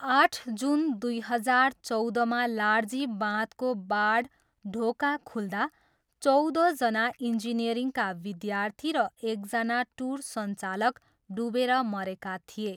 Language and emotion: Nepali, neutral